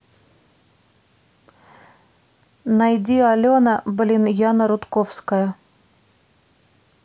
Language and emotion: Russian, neutral